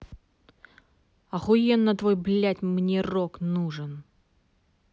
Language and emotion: Russian, angry